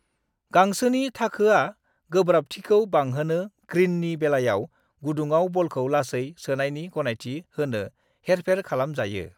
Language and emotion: Bodo, neutral